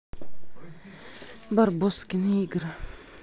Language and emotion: Russian, neutral